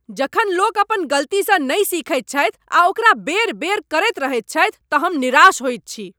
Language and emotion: Maithili, angry